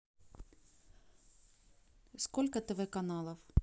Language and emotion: Russian, neutral